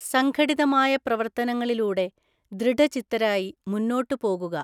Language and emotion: Malayalam, neutral